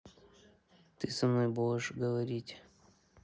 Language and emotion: Russian, neutral